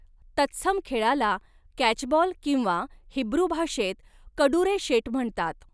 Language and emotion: Marathi, neutral